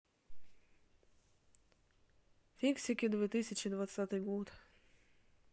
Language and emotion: Russian, neutral